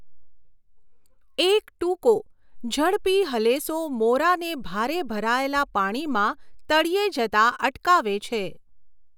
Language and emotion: Gujarati, neutral